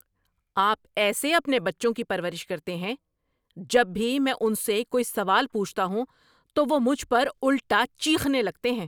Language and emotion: Urdu, angry